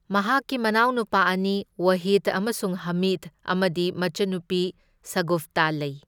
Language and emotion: Manipuri, neutral